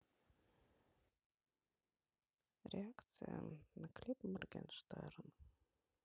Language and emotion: Russian, sad